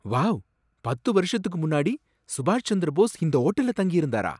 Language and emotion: Tamil, surprised